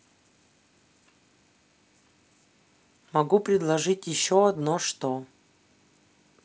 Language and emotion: Russian, neutral